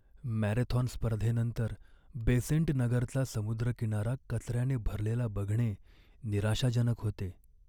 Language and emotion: Marathi, sad